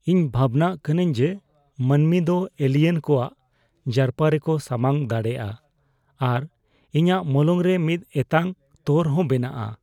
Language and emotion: Santali, fearful